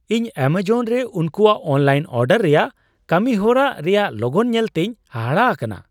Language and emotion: Santali, surprised